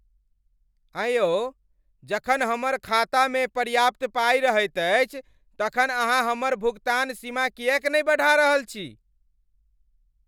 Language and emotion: Maithili, angry